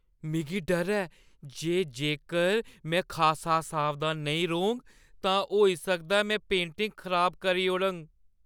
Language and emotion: Dogri, fearful